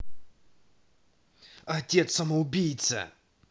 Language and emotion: Russian, angry